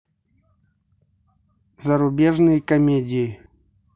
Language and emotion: Russian, neutral